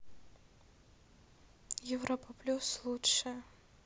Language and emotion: Russian, neutral